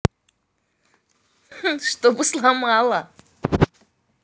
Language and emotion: Russian, positive